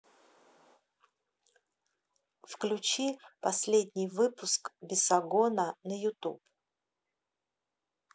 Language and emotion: Russian, neutral